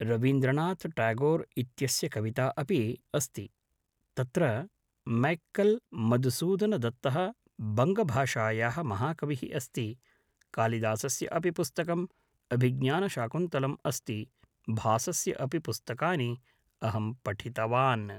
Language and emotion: Sanskrit, neutral